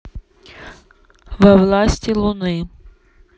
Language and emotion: Russian, neutral